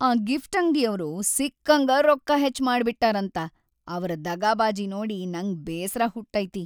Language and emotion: Kannada, sad